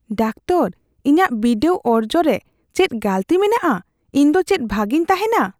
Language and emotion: Santali, fearful